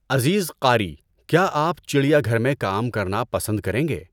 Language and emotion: Urdu, neutral